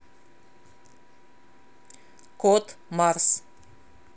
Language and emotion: Russian, neutral